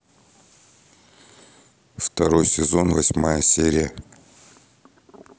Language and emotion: Russian, neutral